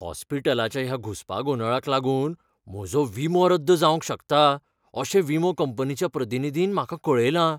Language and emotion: Goan Konkani, fearful